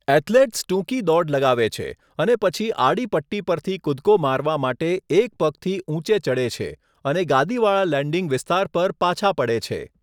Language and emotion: Gujarati, neutral